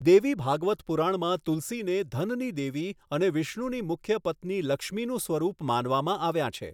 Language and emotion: Gujarati, neutral